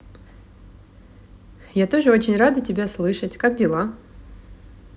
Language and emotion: Russian, positive